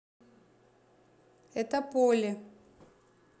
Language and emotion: Russian, neutral